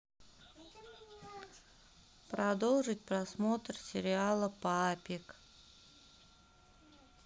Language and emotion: Russian, neutral